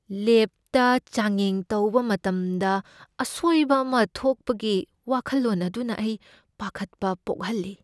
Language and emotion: Manipuri, fearful